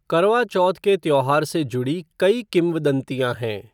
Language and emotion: Hindi, neutral